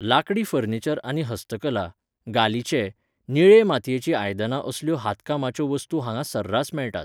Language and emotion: Goan Konkani, neutral